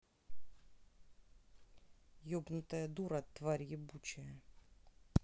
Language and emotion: Russian, angry